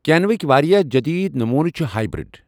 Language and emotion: Kashmiri, neutral